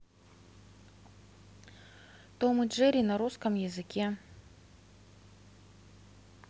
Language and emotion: Russian, neutral